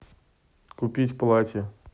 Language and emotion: Russian, neutral